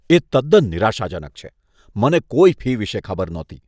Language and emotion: Gujarati, disgusted